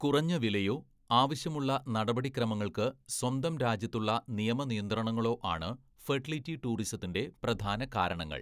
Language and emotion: Malayalam, neutral